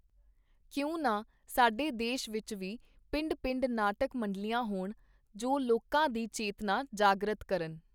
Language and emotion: Punjabi, neutral